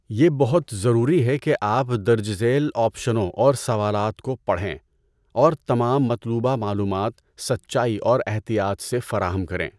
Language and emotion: Urdu, neutral